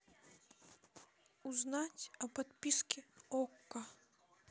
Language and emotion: Russian, sad